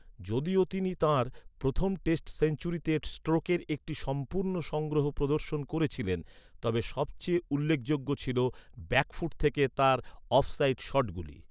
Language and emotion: Bengali, neutral